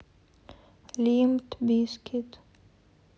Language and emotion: Russian, sad